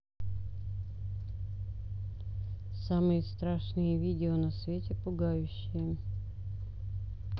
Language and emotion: Russian, neutral